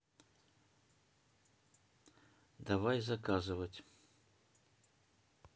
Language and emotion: Russian, neutral